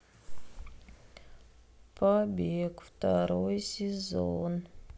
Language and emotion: Russian, sad